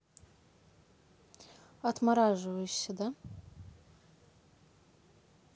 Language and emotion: Russian, neutral